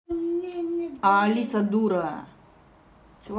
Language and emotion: Russian, angry